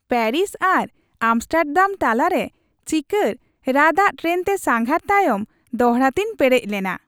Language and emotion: Santali, happy